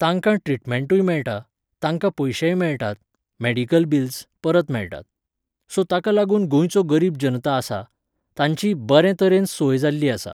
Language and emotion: Goan Konkani, neutral